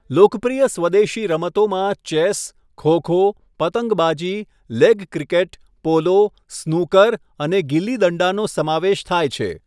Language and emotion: Gujarati, neutral